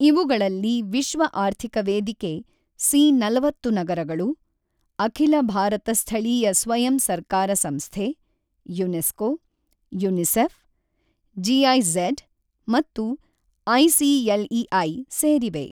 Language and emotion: Kannada, neutral